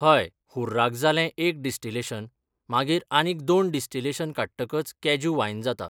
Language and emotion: Goan Konkani, neutral